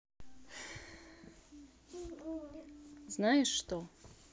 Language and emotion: Russian, neutral